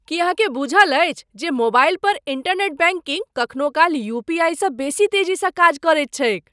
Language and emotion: Maithili, surprised